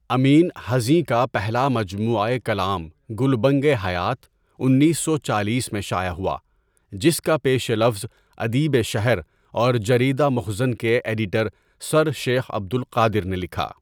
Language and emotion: Urdu, neutral